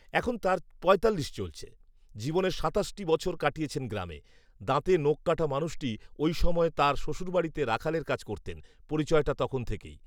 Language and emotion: Bengali, neutral